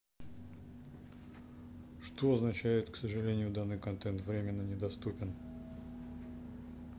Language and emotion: Russian, neutral